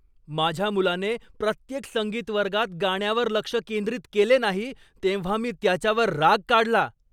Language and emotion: Marathi, angry